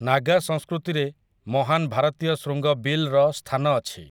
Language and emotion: Odia, neutral